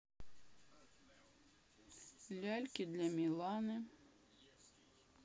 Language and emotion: Russian, neutral